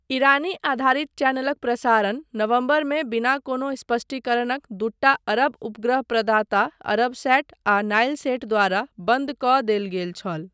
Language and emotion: Maithili, neutral